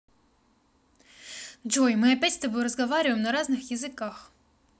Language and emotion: Russian, angry